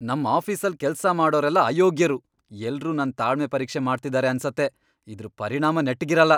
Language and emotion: Kannada, angry